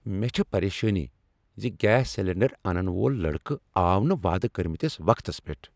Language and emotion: Kashmiri, angry